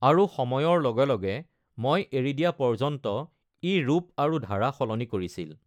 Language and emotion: Assamese, neutral